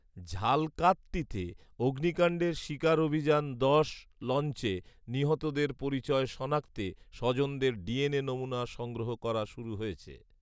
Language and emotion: Bengali, neutral